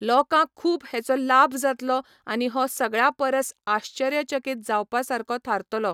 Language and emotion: Goan Konkani, neutral